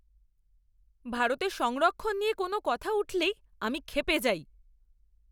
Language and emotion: Bengali, angry